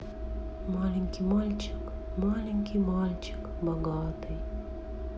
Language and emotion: Russian, sad